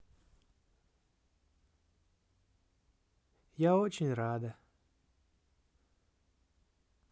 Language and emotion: Russian, positive